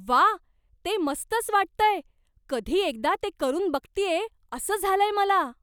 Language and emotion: Marathi, surprised